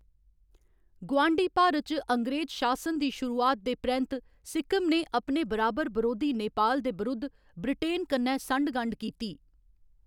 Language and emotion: Dogri, neutral